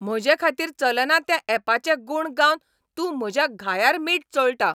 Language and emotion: Goan Konkani, angry